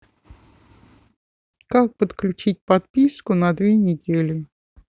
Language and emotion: Russian, neutral